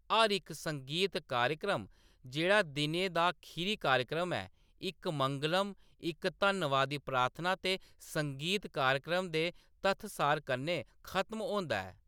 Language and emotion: Dogri, neutral